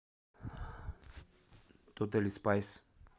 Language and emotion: Russian, neutral